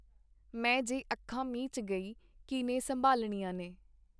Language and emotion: Punjabi, neutral